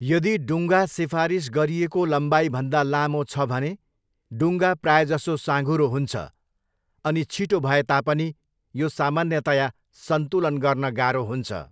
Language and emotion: Nepali, neutral